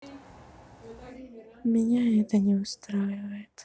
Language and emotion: Russian, sad